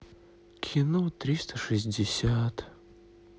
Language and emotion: Russian, sad